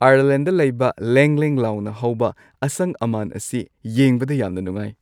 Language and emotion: Manipuri, happy